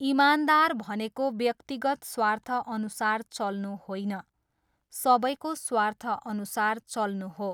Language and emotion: Nepali, neutral